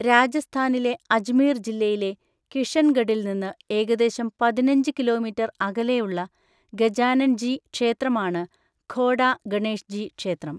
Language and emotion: Malayalam, neutral